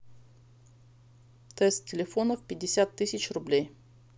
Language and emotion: Russian, neutral